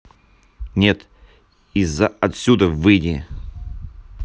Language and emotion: Russian, angry